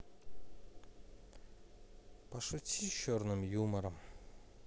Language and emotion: Russian, sad